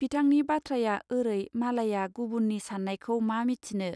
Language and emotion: Bodo, neutral